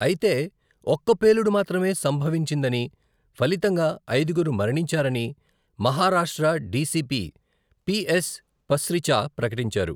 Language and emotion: Telugu, neutral